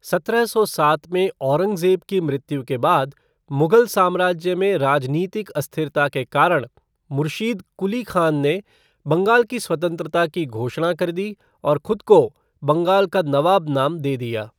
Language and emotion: Hindi, neutral